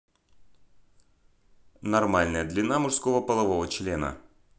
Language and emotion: Russian, neutral